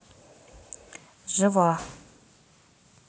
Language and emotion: Russian, neutral